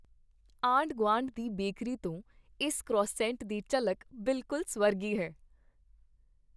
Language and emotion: Punjabi, happy